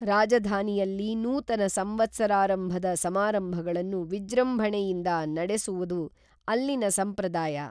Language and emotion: Kannada, neutral